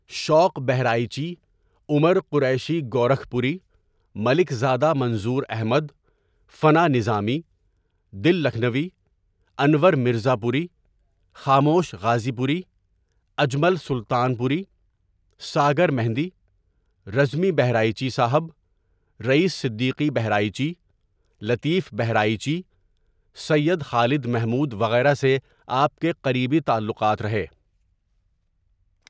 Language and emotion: Urdu, neutral